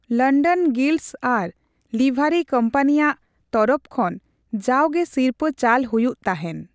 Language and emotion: Santali, neutral